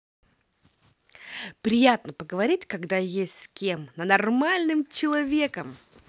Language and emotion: Russian, positive